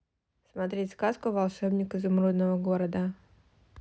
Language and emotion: Russian, neutral